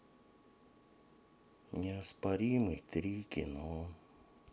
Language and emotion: Russian, sad